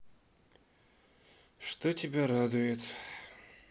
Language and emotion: Russian, sad